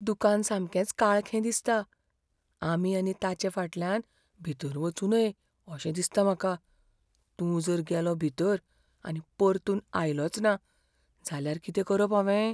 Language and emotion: Goan Konkani, fearful